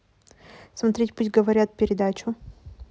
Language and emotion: Russian, neutral